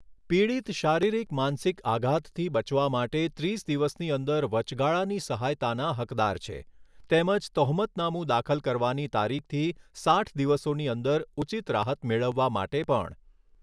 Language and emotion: Gujarati, neutral